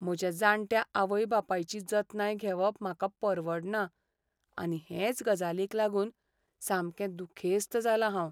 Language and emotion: Goan Konkani, sad